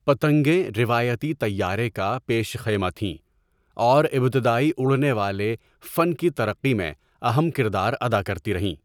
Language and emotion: Urdu, neutral